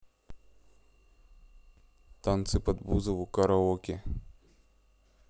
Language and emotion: Russian, neutral